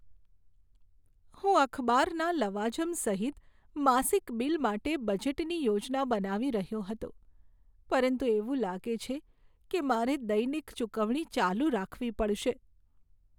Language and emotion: Gujarati, sad